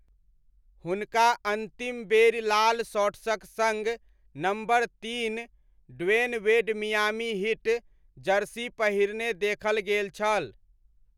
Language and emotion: Maithili, neutral